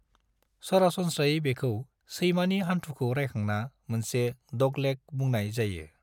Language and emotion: Bodo, neutral